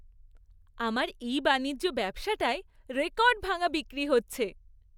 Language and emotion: Bengali, happy